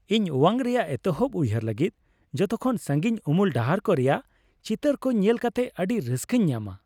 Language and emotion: Santali, happy